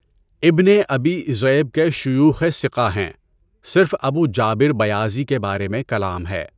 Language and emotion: Urdu, neutral